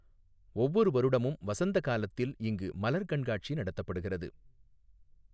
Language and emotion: Tamil, neutral